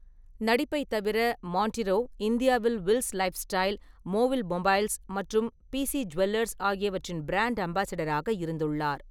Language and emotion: Tamil, neutral